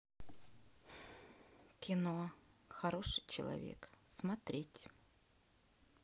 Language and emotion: Russian, neutral